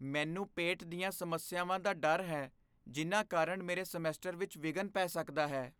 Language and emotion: Punjabi, fearful